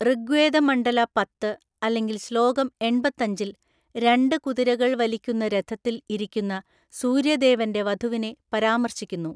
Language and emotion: Malayalam, neutral